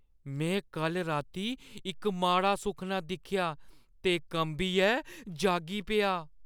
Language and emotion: Dogri, fearful